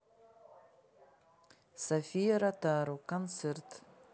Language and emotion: Russian, neutral